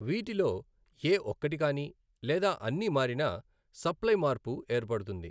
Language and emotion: Telugu, neutral